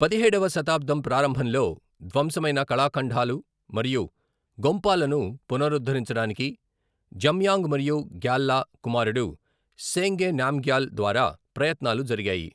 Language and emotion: Telugu, neutral